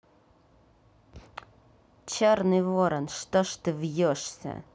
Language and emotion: Russian, angry